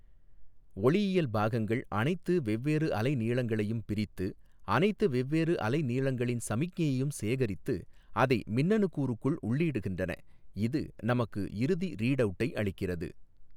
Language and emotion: Tamil, neutral